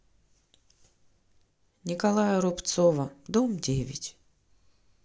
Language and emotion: Russian, neutral